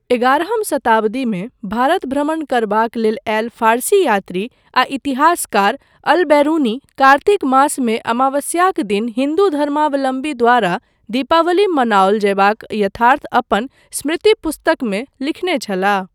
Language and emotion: Maithili, neutral